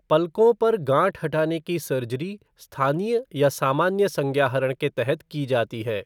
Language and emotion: Hindi, neutral